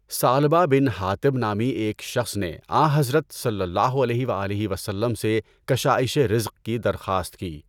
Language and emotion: Urdu, neutral